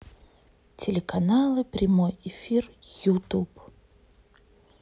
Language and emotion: Russian, neutral